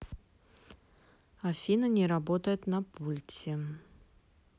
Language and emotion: Russian, neutral